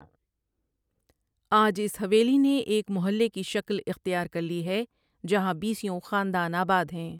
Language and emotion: Urdu, neutral